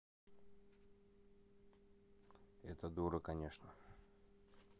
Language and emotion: Russian, neutral